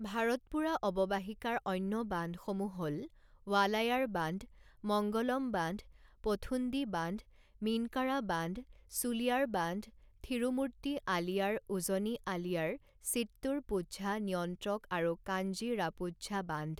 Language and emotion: Assamese, neutral